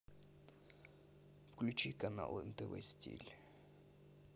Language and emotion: Russian, neutral